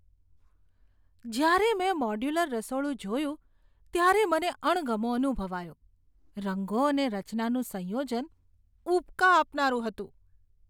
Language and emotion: Gujarati, disgusted